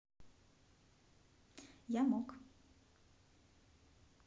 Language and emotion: Russian, neutral